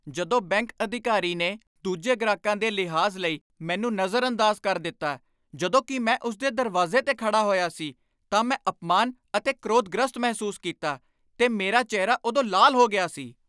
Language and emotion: Punjabi, angry